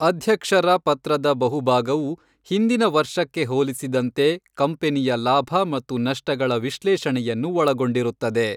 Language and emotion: Kannada, neutral